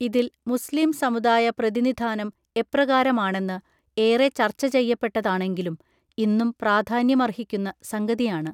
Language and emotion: Malayalam, neutral